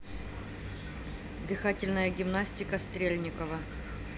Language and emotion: Russian, neutral